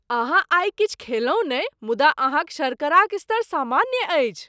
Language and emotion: Maithili, surprised